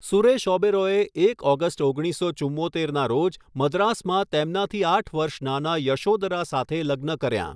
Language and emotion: Gujarati, neutral